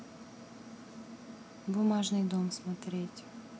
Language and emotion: Russian, neutral